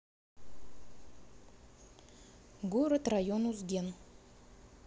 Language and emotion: Russian, neutral